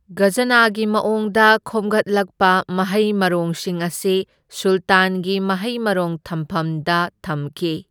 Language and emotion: Manipuri, neutral